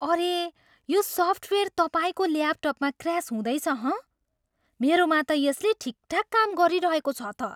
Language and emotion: Nepali, surprised